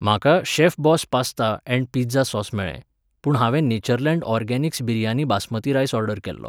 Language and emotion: Goan Konkani, neutral